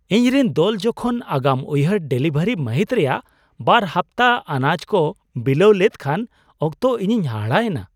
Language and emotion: Santali, surprised